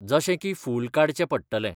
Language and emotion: Goan Konkani, neutral